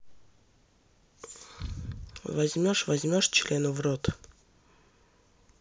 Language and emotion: Russian, neutral